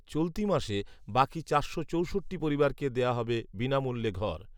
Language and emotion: Bengali, neutral